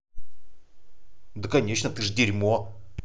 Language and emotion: Russian, angry